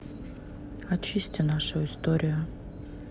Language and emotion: Russian, sad